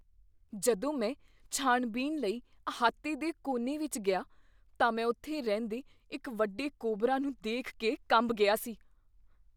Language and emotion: Punjabi, fearful